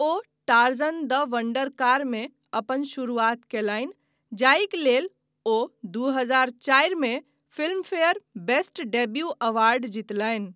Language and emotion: Maithili, neutral